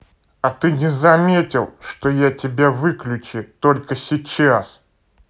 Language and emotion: Russian, angry